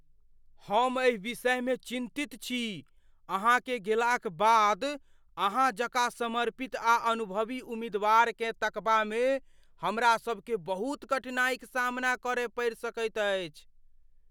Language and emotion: Maithili, fearful